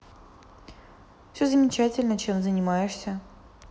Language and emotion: Russian, neutral